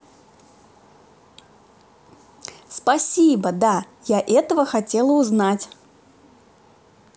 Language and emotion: Russian, positive